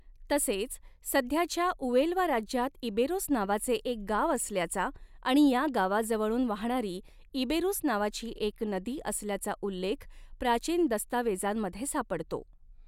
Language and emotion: Marathi, neutral